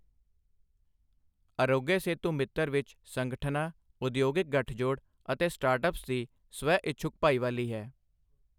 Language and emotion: Punjabi, neutral